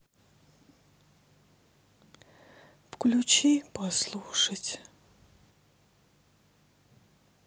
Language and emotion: Russian, sad